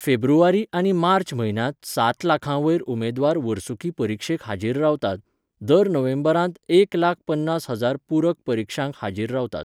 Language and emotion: Goan Konkani, neutral